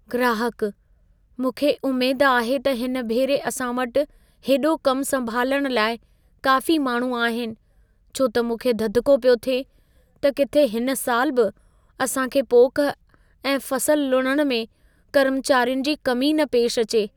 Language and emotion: Sindhi, fearful